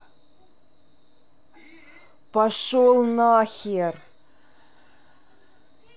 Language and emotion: Russian, angry